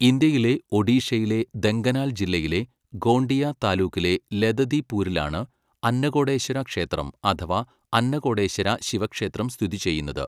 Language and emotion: Malayalam, neutral